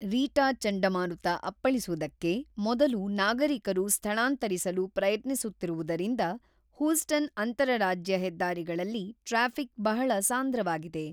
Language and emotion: Kannada, neutral